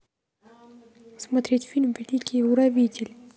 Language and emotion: Russian, neutral